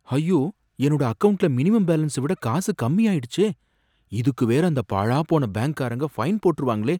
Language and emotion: Tamil, fearful